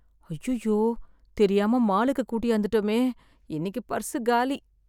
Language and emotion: Tamil, sad